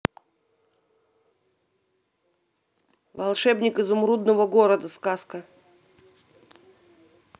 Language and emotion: Russian, neutral